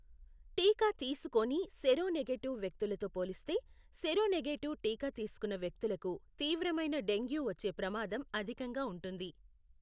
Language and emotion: Telugu, neutral